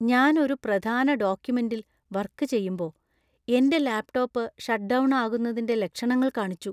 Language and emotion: Malayalam, fearful